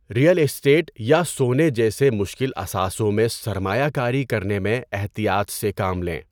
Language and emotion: Urdu, neutral